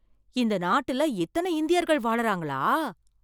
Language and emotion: Tamil, surprised